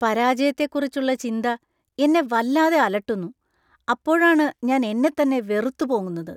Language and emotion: Malayalam, disgusted